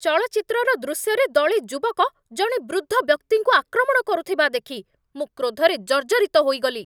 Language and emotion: Odia, angry